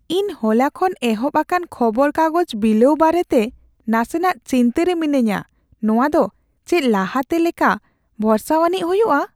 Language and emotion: Santali, fearful